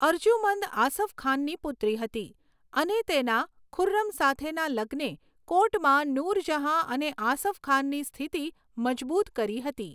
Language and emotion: Gujarati, neutral